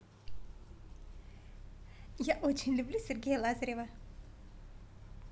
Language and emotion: Russian, positive